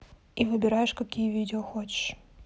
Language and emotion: Russian, neutral